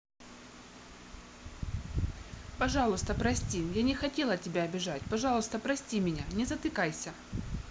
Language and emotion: Russian, neutral